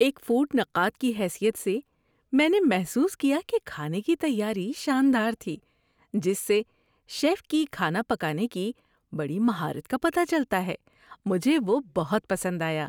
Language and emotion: Urdu, happy